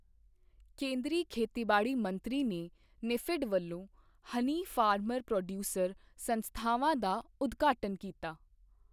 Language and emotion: Punjabi, neutral